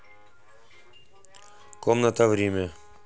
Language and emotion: Russian, neutral